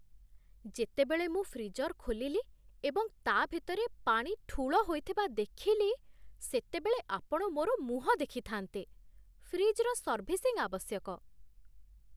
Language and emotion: Odia, surprised